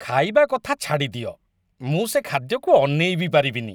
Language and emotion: Odia, disgusted